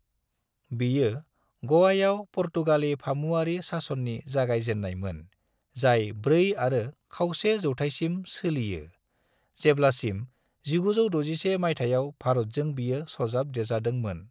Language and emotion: Bodo, neutral